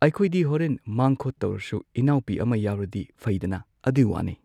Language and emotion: Manipuri, neutral